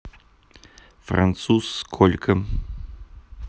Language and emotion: Russian, neutral